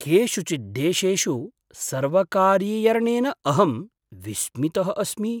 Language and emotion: Sanskrit, surprised